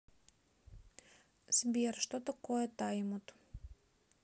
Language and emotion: Russian, neutral